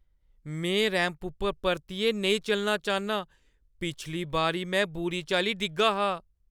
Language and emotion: Dogri, fearful